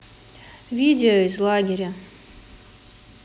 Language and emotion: Russian, neutral